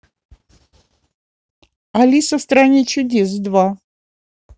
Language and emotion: Russian, positive